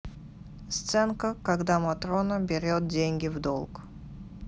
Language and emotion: Russian, neutral